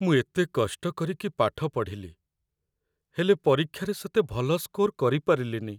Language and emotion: Odia, sad